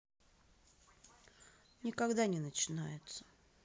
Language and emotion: Russian, neutral